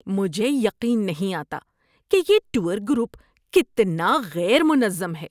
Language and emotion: Urdu, disgusted